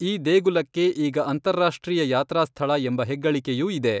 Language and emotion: Kannada, neutral